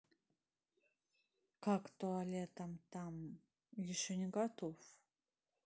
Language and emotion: Russian, neutral